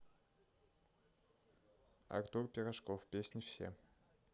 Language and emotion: Russian, neutral